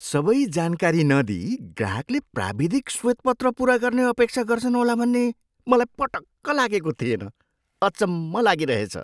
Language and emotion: Nepali, surprised